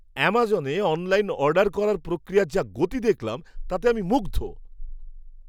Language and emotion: Bengali, surprised